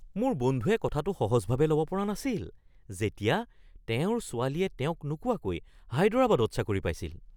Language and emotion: Assamese, surprised